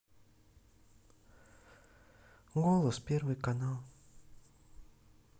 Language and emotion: Russian, sad